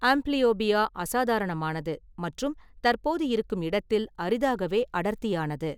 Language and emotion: Tamil, neutral